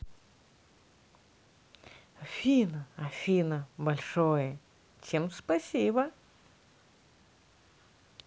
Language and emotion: Russian, positive